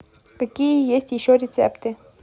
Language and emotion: Russian, neutral